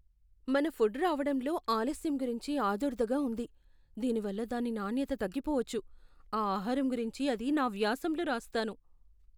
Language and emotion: Telugu, fearful